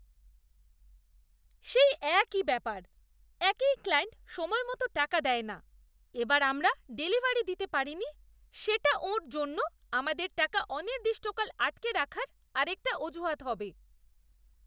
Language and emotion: Bengali, disgusted